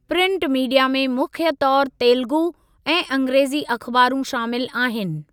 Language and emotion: Sindhi, neutral